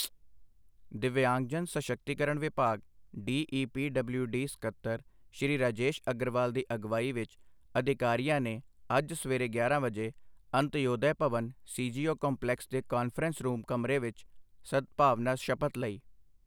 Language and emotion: Punjabi, neutral